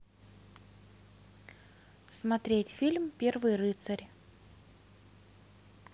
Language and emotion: Russian, neutral